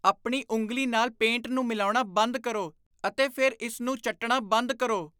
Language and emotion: Punjabi, disgusted